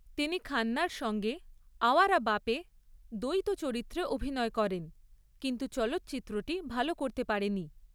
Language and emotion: Bengali, neutral